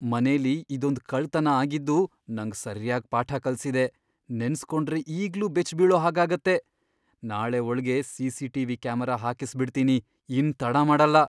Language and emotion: Kannada, fearful